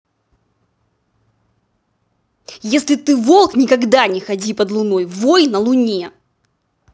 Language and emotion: Russian, angry